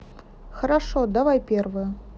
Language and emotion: Russian, neutral